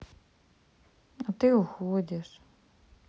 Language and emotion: Russian, sad